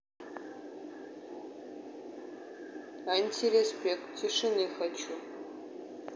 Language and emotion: Russian, neutral